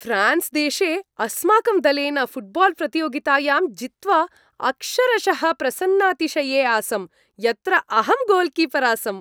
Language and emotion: Sanskrit, happy